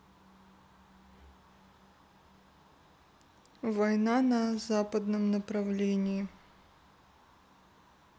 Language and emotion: Russian, neutral